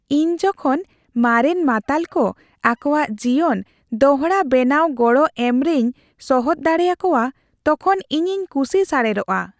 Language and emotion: Santali, happy